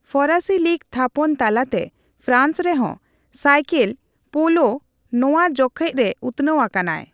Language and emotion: Santali, neutral